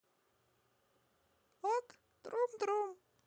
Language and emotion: Russian, positive